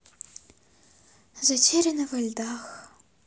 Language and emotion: Russian, sad